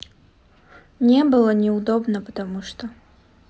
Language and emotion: Russian, sad